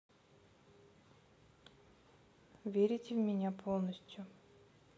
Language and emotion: Russian, neutral